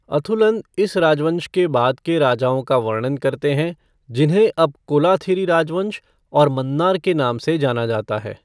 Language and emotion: Hindi, neutral